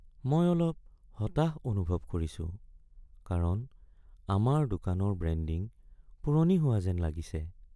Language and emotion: Assamese, sad